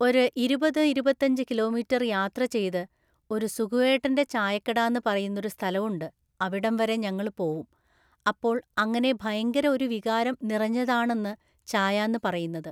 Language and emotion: Malayalam, neutral